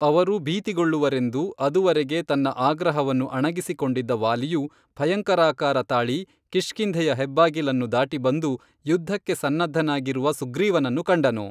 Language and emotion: Kannada, neutral